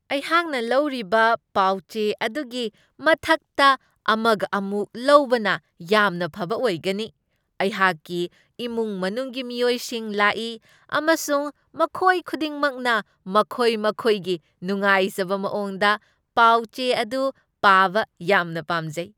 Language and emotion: Manipuri, happy